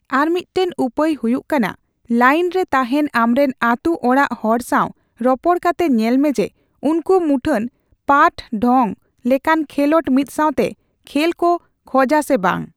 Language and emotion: Santali, neutral